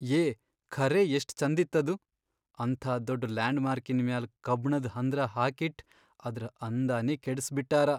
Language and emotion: Kannada, sad